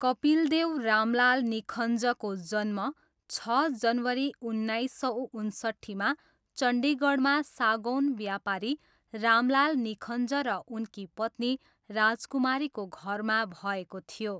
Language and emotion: Nepali, neutral